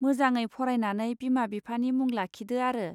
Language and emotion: Bodo, neutral